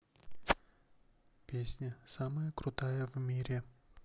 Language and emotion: Russian, neutral